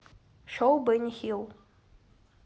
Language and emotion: Russian, neutral